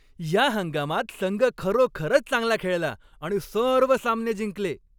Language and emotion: Marathi, happy